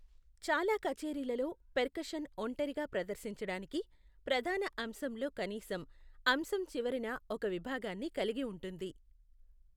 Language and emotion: Telugu, neutral